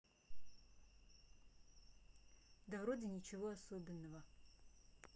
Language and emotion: Russian, neutral